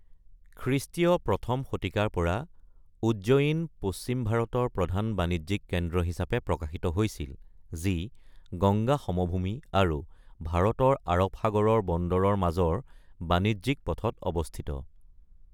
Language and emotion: Assamese, neutral